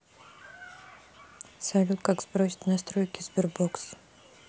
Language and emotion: Russian, neutral